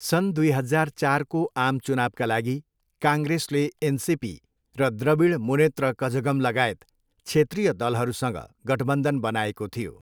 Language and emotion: Nepali, neutral